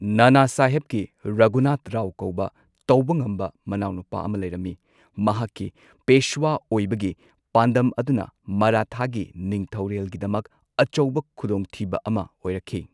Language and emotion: Manipuri, neutral